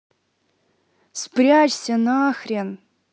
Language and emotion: Russian, angry